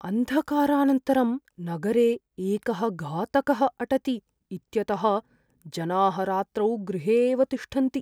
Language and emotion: Sanskrit, fearful